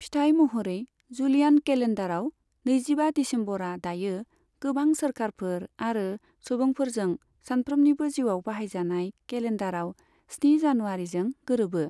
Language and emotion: Bodo, neutral